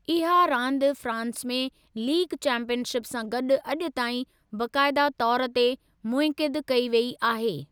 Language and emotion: Sindhi, neutral